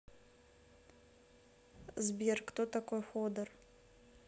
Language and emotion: Russian, neutral